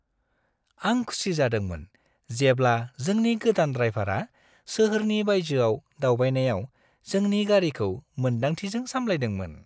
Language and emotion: Bodo, happy